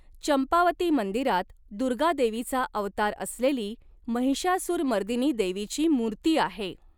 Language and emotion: Marathi, neutral